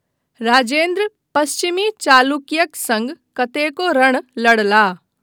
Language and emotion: Maithili, neutral